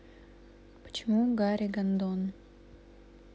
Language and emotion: Russian, neutral